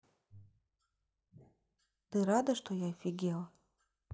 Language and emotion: Russian, neutral